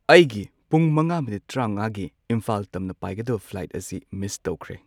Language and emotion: Manipuri, neutral